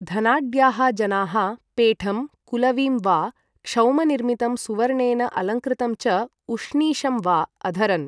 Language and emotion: Sanskrit, neutral